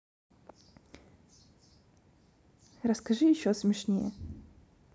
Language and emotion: Russian, neutral